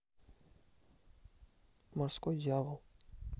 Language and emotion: Russian, neutral